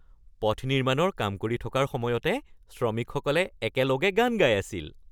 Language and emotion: Assamese, happy